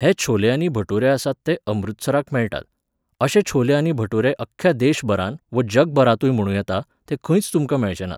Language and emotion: Goan Konkani, neutral